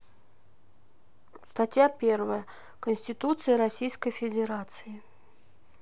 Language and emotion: Russian, sad